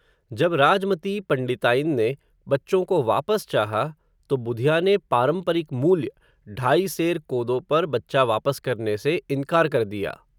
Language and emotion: Hindi, neutral